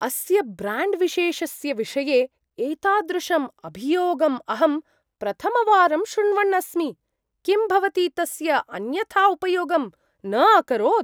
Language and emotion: Sanskrit, surprised